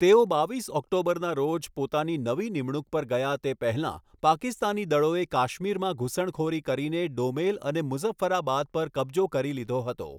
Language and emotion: Gujarati, neutral